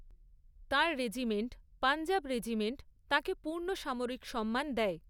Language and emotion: Bengali, neutral